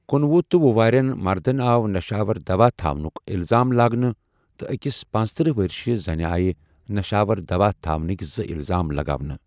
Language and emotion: Kashmiri, neutral